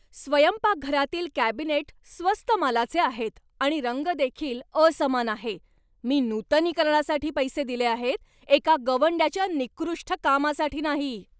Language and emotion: Marathi, angry